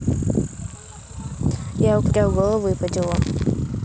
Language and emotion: Russian, neutral